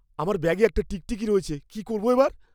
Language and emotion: Bengali, fearful